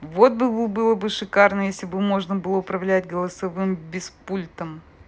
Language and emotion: Russian, neutral